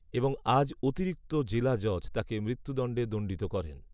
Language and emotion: Bengali, neutral